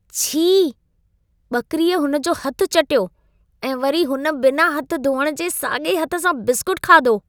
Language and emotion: Sindhi, disgusted